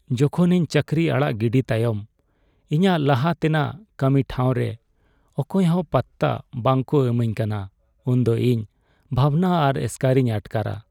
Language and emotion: Santali, sad